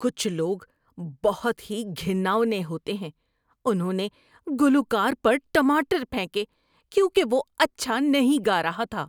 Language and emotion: Urdu, disgusted